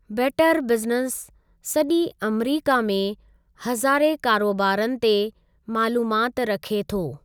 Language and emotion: Sindhi, neutral